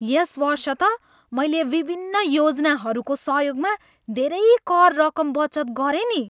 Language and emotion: Nepali, happy